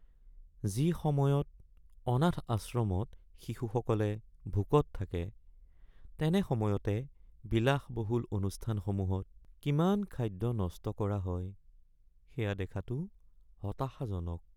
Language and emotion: Assamese, sad